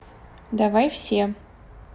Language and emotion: Russian, neutral